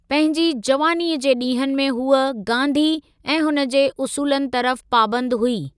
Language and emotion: Sindhi, neutral